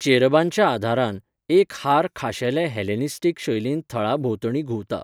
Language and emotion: Goan Konkani, neutral